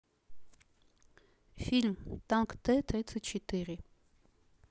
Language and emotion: Russian, neutral